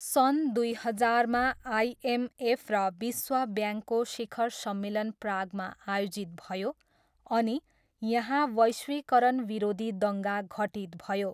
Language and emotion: Nepali, neutral